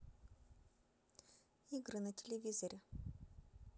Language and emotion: Russian, neutral